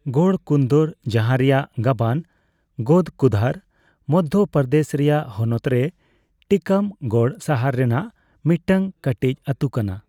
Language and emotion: Santali, neutral